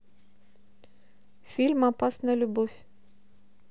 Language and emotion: Russian, neutral